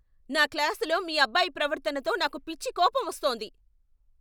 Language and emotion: Telugu, angry